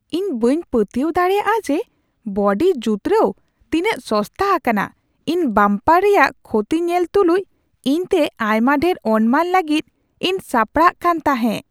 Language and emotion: Santali, surprised